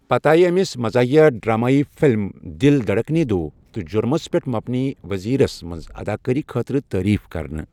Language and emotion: Kashmiri, neutral